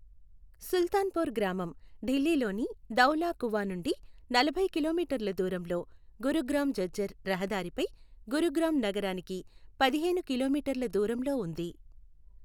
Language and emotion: Telugu, neutral